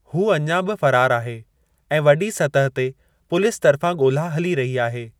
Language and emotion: Sindhi, neutral